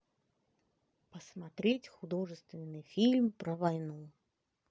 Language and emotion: Russian, positive